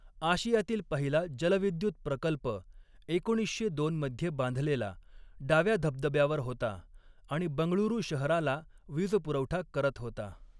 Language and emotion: Marathi, neutral